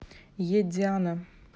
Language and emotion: Russian, neutral